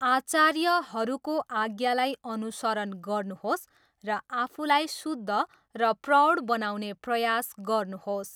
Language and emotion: Nepali, neutral